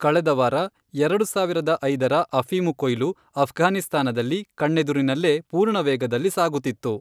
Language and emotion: Kannada, neutral